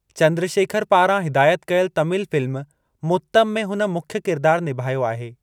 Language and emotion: Sindhi, neutral